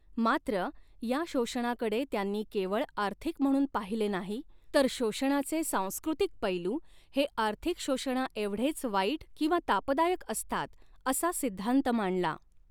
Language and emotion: Marathi, neutral